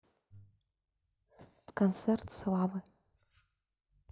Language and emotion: Russian, neutral